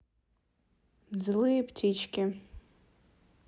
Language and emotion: Russian, neutral